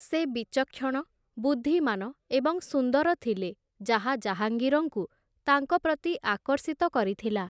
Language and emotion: Odia, neutral